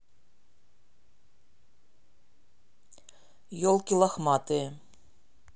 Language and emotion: Russian, neutral